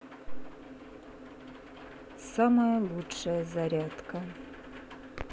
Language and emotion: Russian, sad